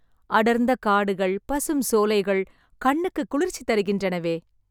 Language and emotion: Tamil, happy